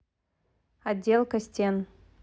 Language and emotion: Russian, neutral